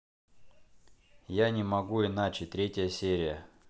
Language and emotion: Russian, neutral